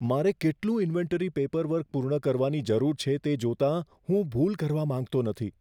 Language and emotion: Gujarati, fearful